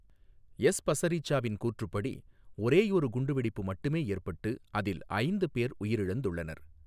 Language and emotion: Tamil, neutral